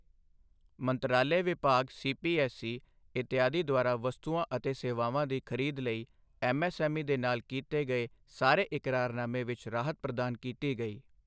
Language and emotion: Punjabi, neutral